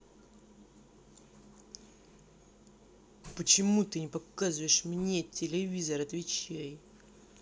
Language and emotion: Russian, angry